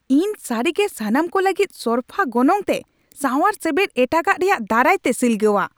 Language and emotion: Santali, angry